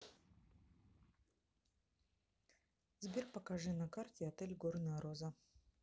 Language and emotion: Russian, neutral